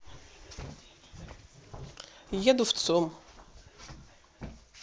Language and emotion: Russian, neutral